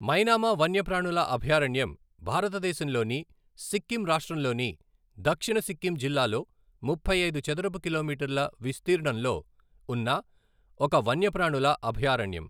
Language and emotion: Telugu, neutral